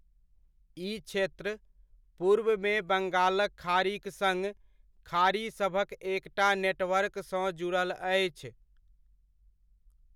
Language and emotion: Maithili, neutral